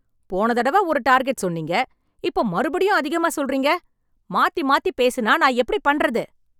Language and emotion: Tamil, angry